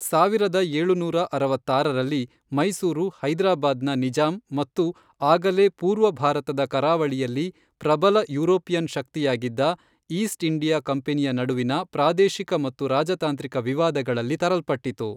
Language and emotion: Kannada, neutral